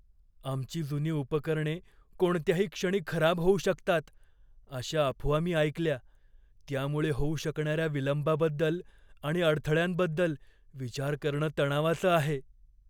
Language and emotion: Marathi, fearful